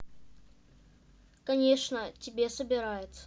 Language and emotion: Russian, neutral